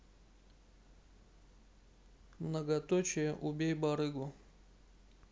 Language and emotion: Russian, neutral